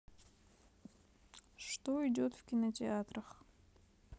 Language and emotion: Russian, neutral